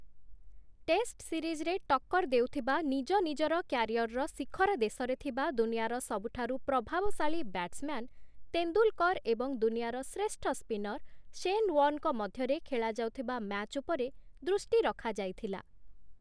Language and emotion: Odia, neutral